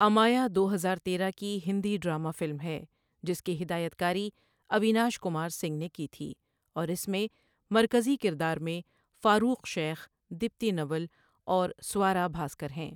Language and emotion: Urdu, neutral